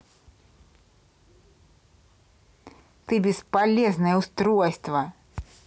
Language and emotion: Russian, angry